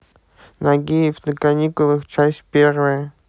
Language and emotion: Russian, neutral